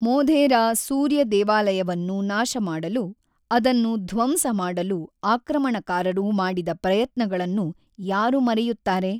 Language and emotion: Kannada, neutral